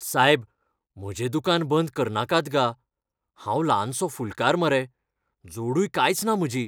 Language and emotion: Goan Konkani, fearful